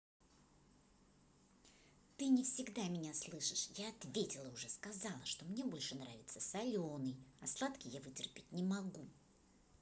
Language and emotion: Russian, angry